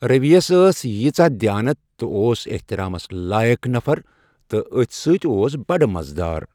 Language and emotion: Kashmiri, neutral